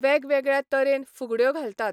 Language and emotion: Goan Konkani, neutral